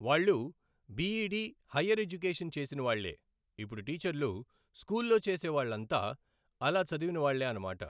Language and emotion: Telugu, neutral